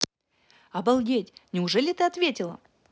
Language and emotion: Russian, positive